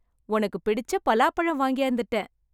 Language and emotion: Tamil, happy